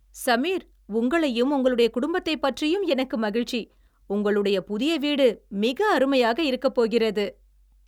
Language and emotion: Tamil, happy